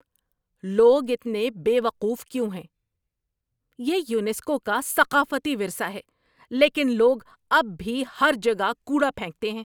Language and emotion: Urdu, angry